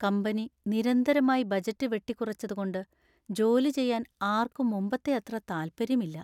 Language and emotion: Malayalam, sad